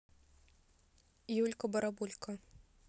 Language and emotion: Russian, neutral